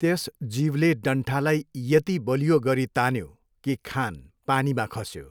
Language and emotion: Nepali, neutral